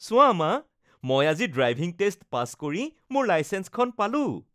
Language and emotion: Assamese, happy